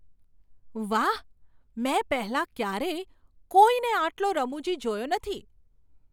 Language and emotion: Gujarati, surprised